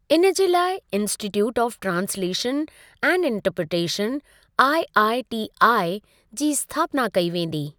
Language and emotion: Sindhi, neutral